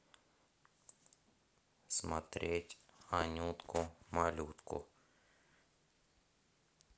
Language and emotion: Russian, neutral